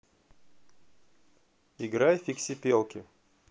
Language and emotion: Russian, neutral